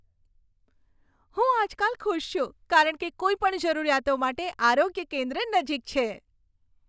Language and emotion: Gujarati, happy